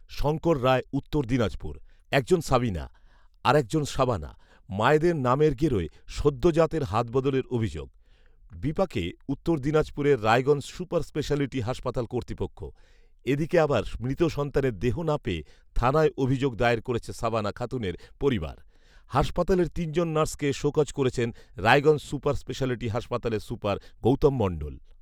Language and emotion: Bengali, neutral